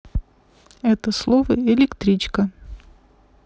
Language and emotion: Russian, neutral